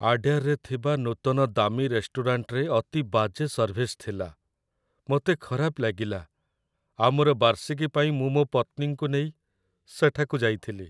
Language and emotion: Odia, sad